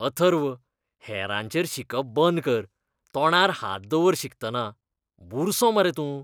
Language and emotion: Goan Konkani, disgusted